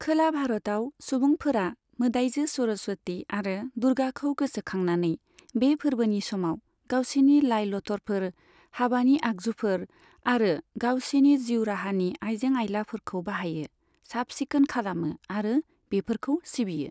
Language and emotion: Bodo, neutral